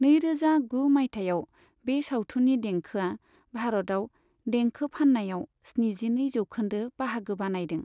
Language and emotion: Bodo, neutral